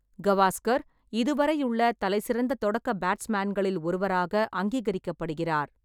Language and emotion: Tamil, neutral